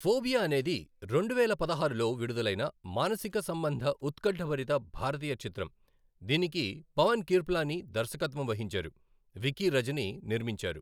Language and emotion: Telugu, neutral